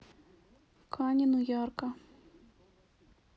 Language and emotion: Russian, sad